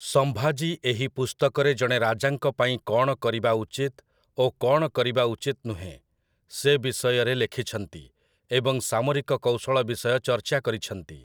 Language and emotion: Odia, neutral